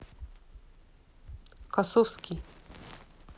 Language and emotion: Russian, neutral